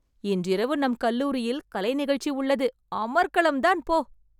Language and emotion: Tamil, happy